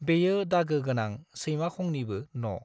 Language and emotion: Bodo, neutral